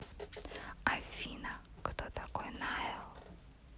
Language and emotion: Russian, neutral